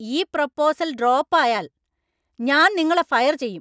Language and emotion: Malayalam, angry